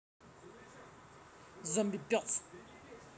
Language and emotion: Russian, neutral